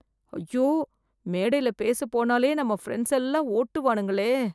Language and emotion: Tamil, fearful